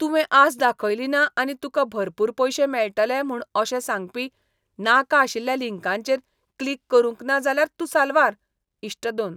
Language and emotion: Goan Konkani, disgusted